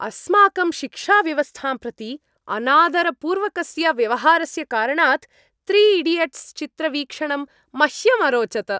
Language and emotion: Sanskrit, happy